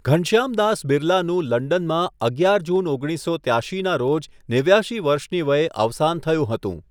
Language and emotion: Gujarati, neutral